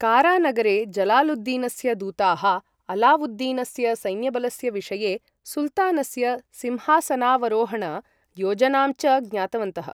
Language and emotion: Sanskrit, neutral